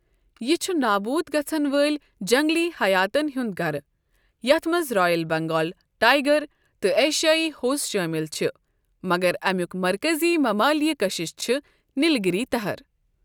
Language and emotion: Kashmiri, neutral